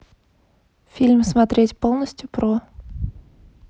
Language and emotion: Russian, neutral